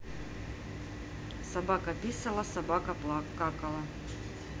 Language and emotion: Russian, neutral